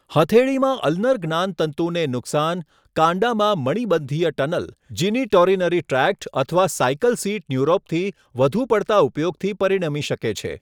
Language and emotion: Gujarati, neutral